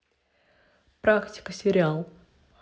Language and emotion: Russian, neutral